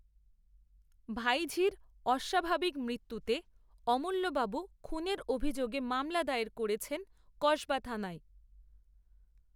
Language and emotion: Bengali, neutral